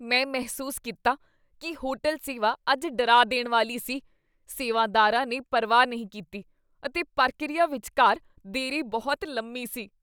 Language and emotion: Punjabi, disgusted